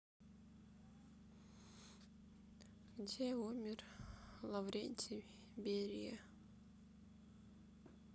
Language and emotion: Russian, sad